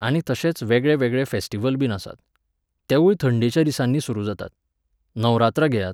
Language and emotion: Goan Konkani, neutral